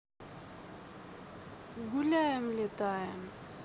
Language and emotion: Russian, neutral